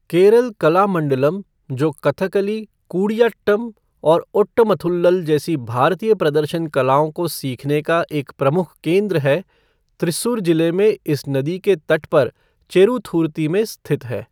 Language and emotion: Hindi, neutral